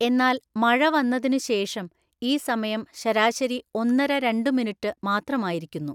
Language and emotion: Malayalam, neutral